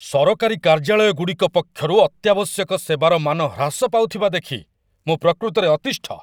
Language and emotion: Odia, angry